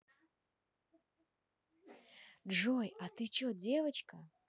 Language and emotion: Russian, neutral